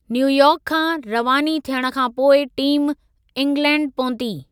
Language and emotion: Sindhi, neutral